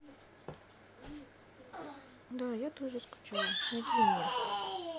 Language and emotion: Russian, sad